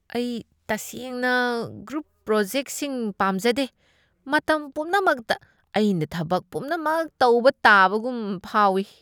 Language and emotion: Manipuri, disgusted